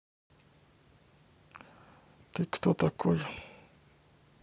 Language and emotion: Russian, neutral